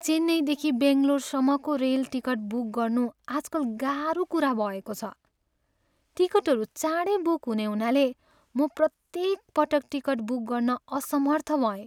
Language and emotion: Nepali, sad